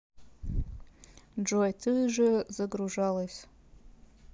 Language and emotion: Russian, neutral